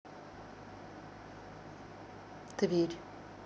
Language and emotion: Russian, neutral